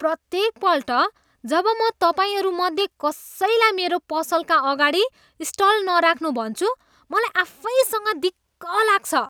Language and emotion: Nepali, disgusted